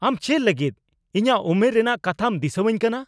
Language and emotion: Santali, angry